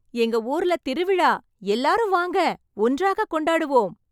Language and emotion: Tamil, happy